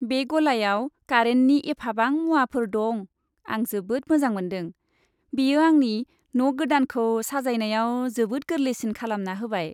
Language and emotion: Bodo, happy